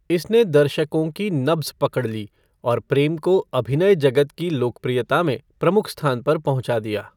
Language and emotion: Hindi, neutral